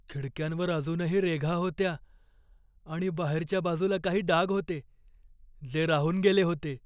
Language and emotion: Marathi, fearful